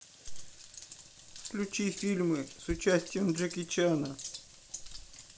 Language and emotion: Russian, sad